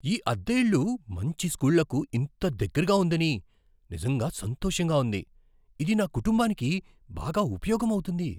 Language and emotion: Telugu, surprised